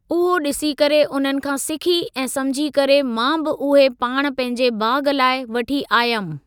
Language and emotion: Sindhi, neutral